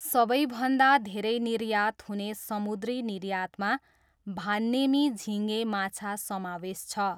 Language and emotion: Nepali, neutral